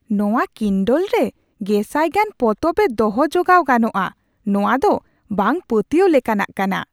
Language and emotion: Santali, surprised